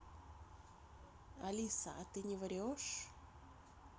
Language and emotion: Russian, neutral